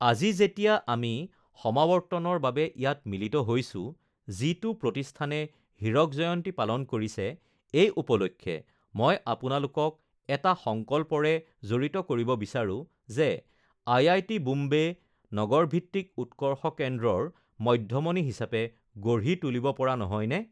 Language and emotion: Assamese, neutral